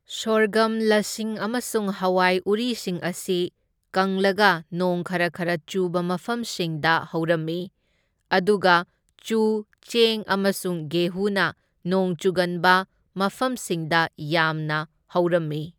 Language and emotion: Manipuri, neutral